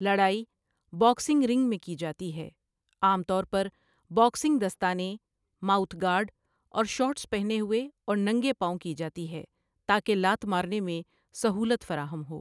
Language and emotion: Urdu, neutral